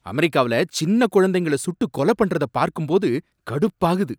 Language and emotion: Tamil, angry